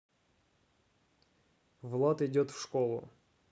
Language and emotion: Russian, neutral